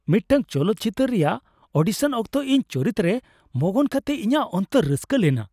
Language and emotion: Santali, happy